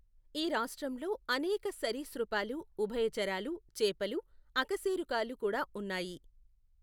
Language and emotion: Telugu, neutral